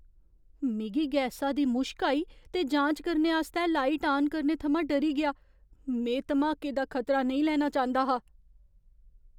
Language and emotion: Dogri, fearful